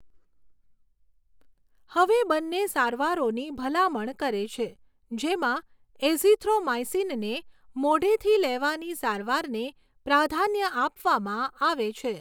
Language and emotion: Gujarati, neutral